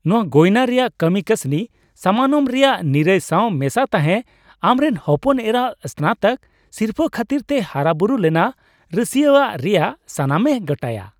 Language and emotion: Santali, happy